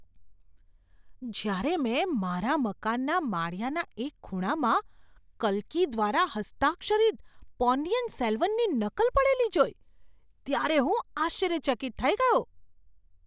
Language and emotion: Gujarati, surprised